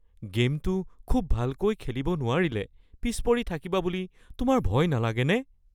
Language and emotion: Assamese, fearful